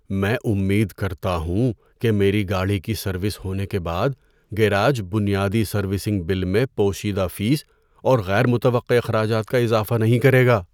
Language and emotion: Urdu, fearful